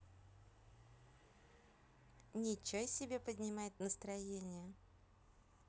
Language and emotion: Russian, positive